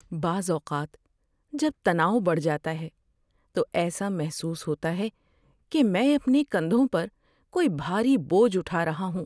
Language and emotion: Urdu, sad